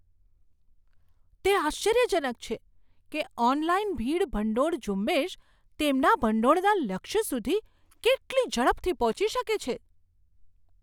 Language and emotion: Gujarati, surprised